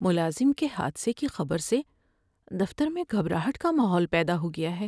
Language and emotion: Urdu, sad